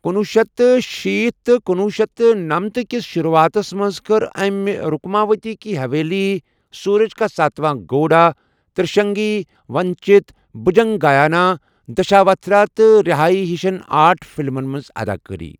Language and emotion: Kashmiri, neutral